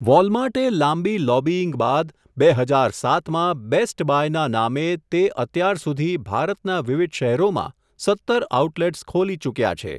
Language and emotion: Gujarati, neutral